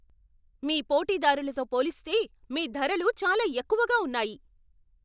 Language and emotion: Telugu, angry